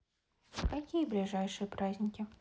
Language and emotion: Russian, neutral